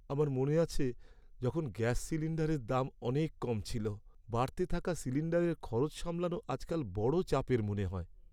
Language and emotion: Bengali, sad